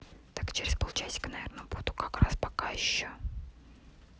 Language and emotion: Russian, neutral